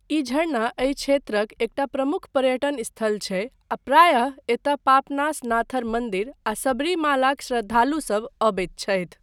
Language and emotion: Maithili, neutral